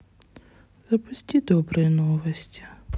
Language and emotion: Russian, sad